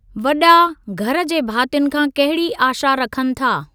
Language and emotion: Sindhi, neutral